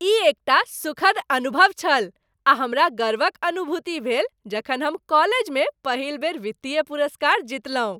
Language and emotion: Maithili, happy